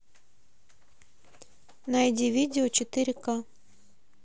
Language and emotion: Russian, neutral